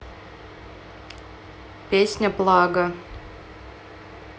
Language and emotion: Russian, neutral